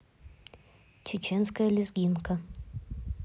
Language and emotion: Russian, neutral